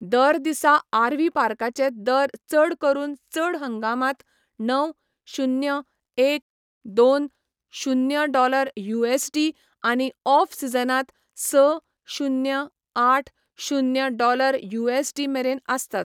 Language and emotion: Goan Konkani, neutral